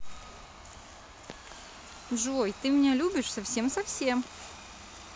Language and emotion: Russian, positive